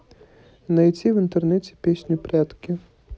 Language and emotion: Russian, neutral